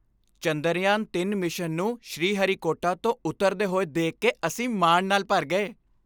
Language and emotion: Punjabi, happy